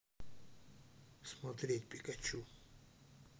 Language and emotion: Russian, neutral